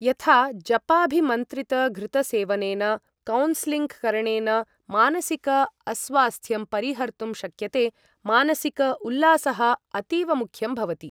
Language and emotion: Sanskrit, neutral